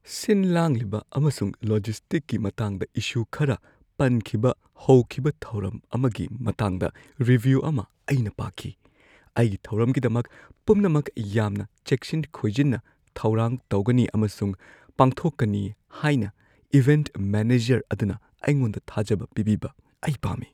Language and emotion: Manipuri, fearful